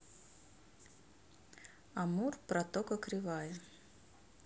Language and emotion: Russian, neutral